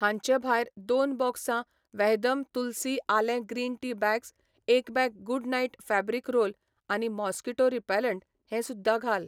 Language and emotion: Goan Konkani, neutral